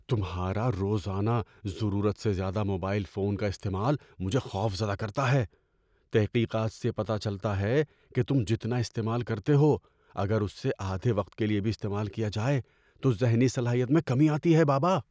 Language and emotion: Urdu, fearful